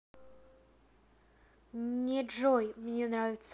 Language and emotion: Russian, neutral